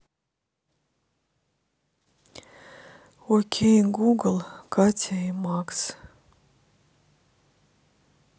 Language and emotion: Russian, sad